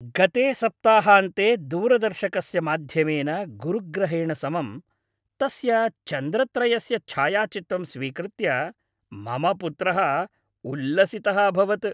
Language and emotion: Sanskrit, happy